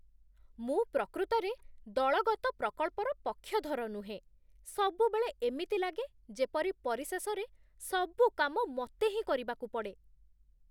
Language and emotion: Odia, disgusted